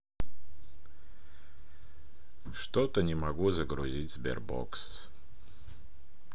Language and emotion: Russian, sad